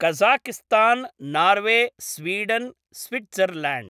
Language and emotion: Sanskrit, neutral